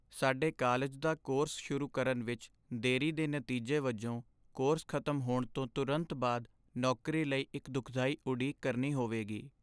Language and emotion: Punjabi, sad